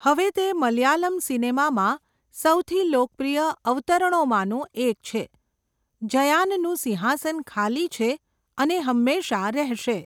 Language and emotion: Gujarati, neutral